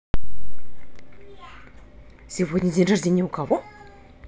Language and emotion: Russian, neutral